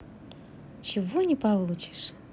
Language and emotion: Russian, positive